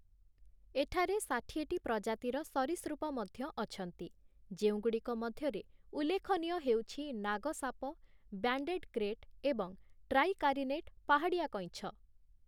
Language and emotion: Odia, neutral